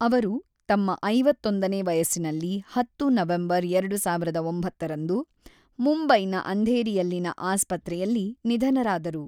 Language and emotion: Kannada, neutral